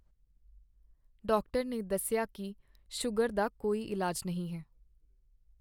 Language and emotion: Punjabi, sad